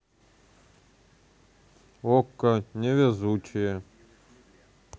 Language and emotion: Russian, neutral